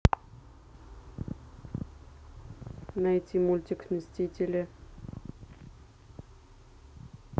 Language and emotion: Russian, neutral